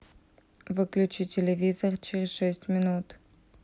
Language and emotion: Russian, neutral